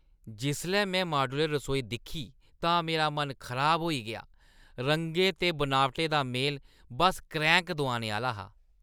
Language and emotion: Dogri, disgusted